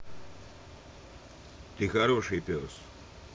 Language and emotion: Russian, neutral